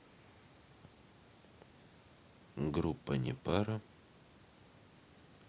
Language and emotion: Russian, neutral